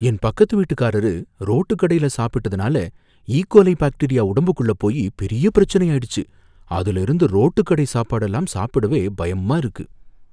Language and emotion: Tamil, fearful